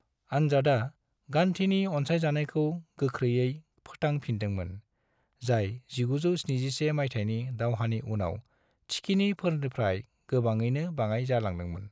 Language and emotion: Bodo, neutral